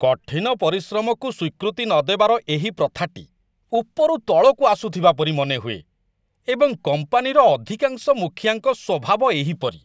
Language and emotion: Odia, disgusted